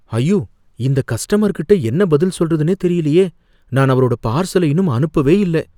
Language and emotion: Tamil, fearful